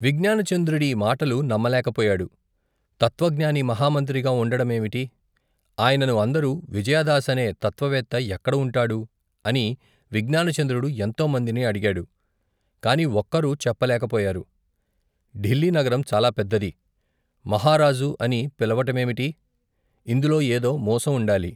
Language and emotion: Telugu, neutral